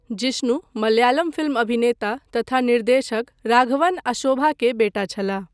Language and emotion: Maithili, neutral